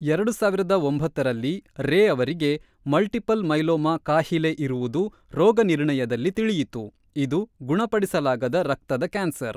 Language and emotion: Kannada, neutral